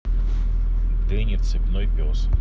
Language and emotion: Russian, neutral